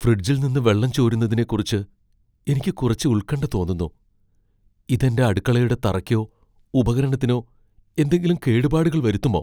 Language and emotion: Malayalam, fearful